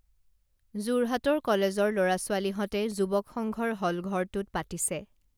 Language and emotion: Assamese, neutral